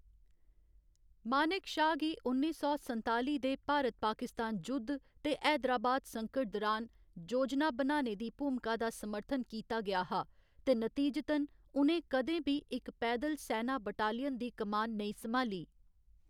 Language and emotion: Dogri, neutral